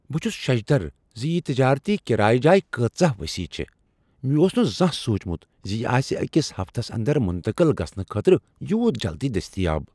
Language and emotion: Kashmiri, surprised